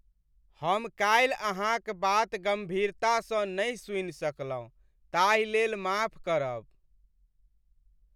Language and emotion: Maithili, sad